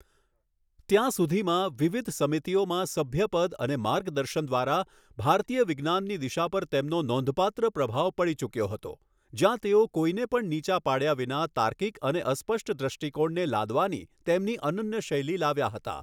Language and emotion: Gujarati, neutral